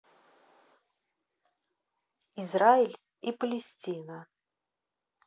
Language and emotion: Russian, neutral